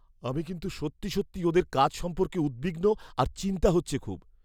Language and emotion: Bengali, fearful